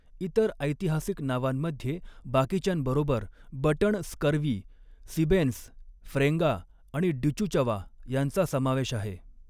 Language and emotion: Marathi, neutral